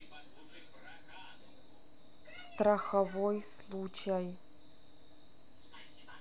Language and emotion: Russian, neutral